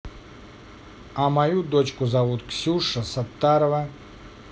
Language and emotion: Russian, positive